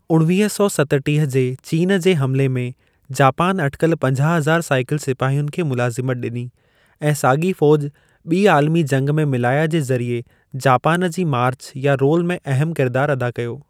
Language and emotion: Sindhi, neutral